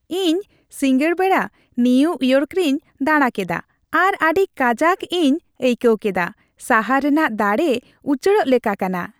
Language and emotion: Santali, happy